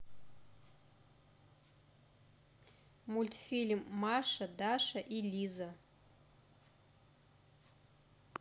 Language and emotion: Russian, neutral